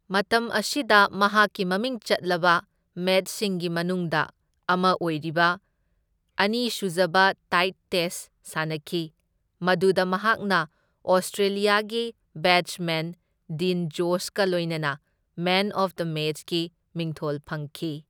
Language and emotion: Manipuri, neutral